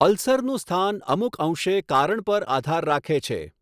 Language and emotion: Gujarati, neutral